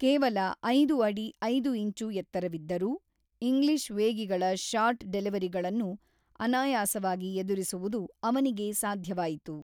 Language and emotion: Kannada, neutral